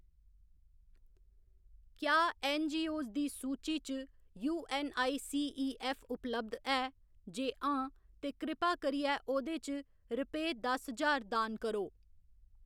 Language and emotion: Dogri, neutral